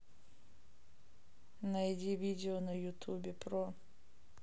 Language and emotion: Russian, neutral